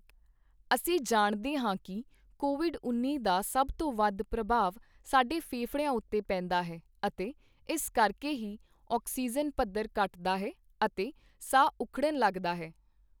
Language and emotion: Punjabi, neutral